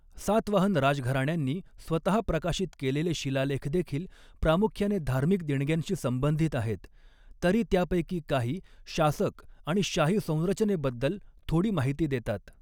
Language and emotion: Marathi, neutral